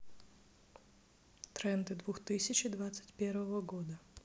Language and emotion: Russian, neutral